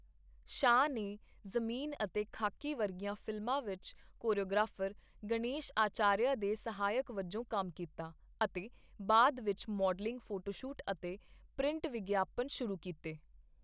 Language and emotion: Punjabi, neutral